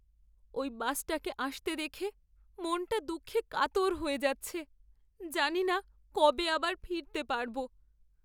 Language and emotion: Bengali, sad